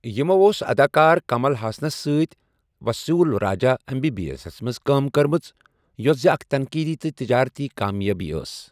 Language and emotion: Kashmiri, neutral